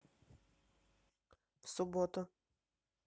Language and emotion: Russian, neutral